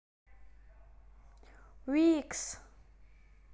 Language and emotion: Russian, positive